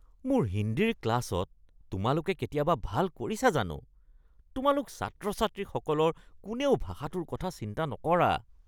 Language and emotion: Assamese, disgusted